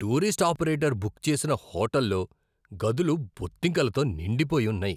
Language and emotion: Telugu, disgusted